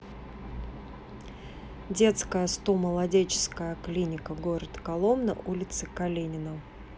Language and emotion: Russian, neutral